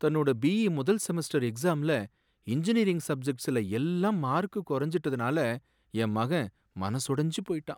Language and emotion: Tamil, sad